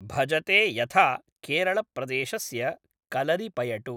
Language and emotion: Sanskrit, neutral